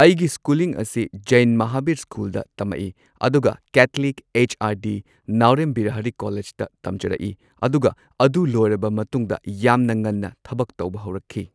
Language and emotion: Manipuri, neutral